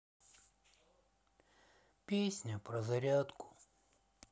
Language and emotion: Russian, sad